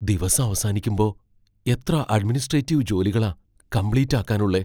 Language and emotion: Malayalam, fearful